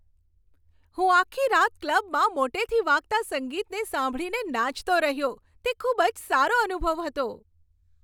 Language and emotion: Gujarati, happy